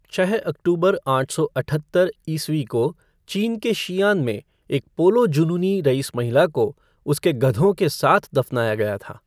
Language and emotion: Hindi, neutral